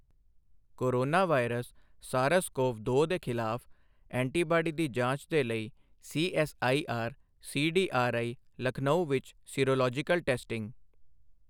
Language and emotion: Punjabi, neutral